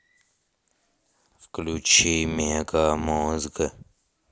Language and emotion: Russian, neutral